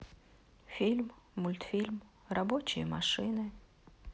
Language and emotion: Russian, sad